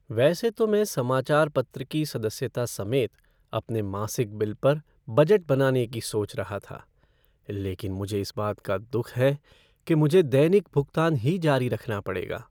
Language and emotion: Hindi, sad